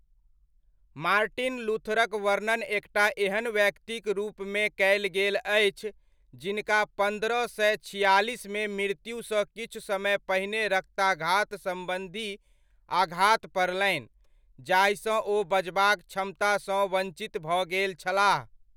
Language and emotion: Maithili, neutral